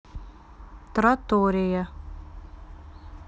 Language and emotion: Russian, neutral